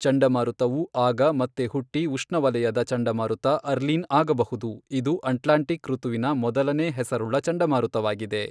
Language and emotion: Kannada, neutral